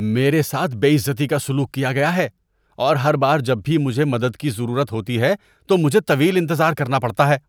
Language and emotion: Urdu, disgusted